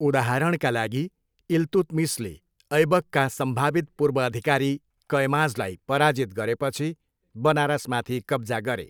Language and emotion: Nepali, neutral